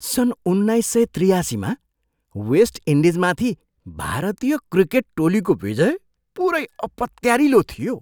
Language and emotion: Nepali, surprised